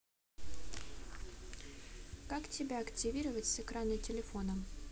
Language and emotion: Russian, neutral